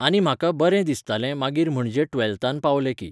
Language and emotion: Goan Konkani, neutral